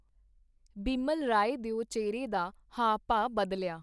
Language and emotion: Punjabi, neutral